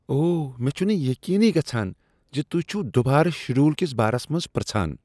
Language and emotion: Kashmiri, disgusted